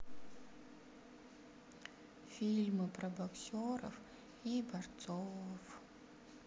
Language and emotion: Russian, sad